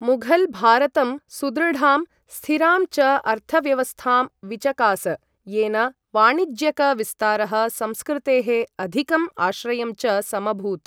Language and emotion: Sanskrit, neutral